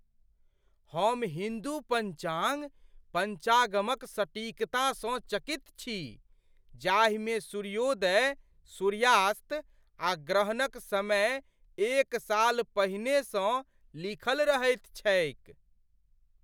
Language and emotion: Maithili, surprised